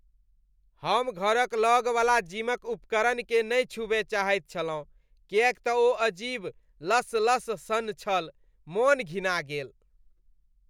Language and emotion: Maithili, disgusted